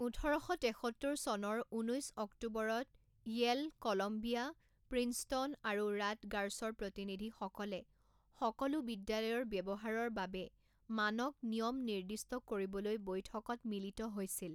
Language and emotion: Assamese, neutral